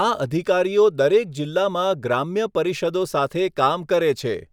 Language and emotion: Gujarati, neutral